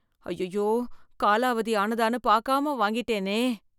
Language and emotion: Tamil, fearful